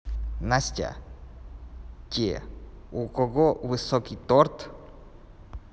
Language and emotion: Russian, neutral